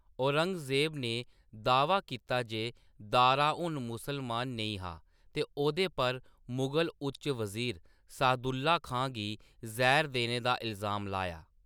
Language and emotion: Dogri, neutral